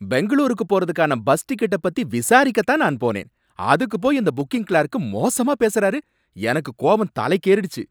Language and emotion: Tamil, angry